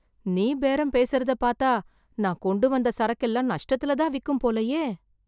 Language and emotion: Tamil, fearful